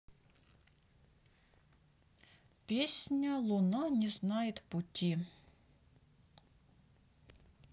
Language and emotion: Russian, neutral